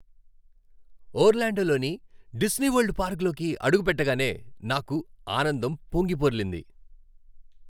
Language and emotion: Telugu, happy